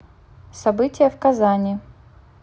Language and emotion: Russian, neutral